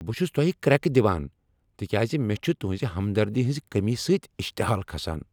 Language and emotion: Kashmiri, angry